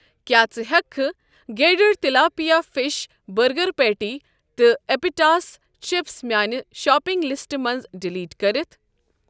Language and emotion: Kashmiri, neutral